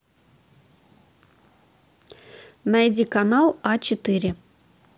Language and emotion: Russian, neutral